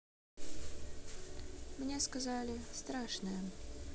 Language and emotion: Russian, neutral